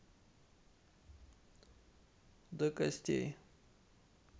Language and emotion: Russian, neutral